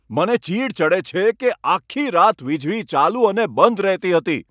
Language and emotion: Gujarati, angry